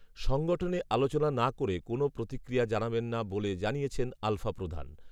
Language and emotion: Bengali, neutral